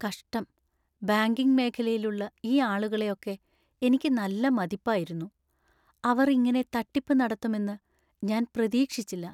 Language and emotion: Malayalam, sad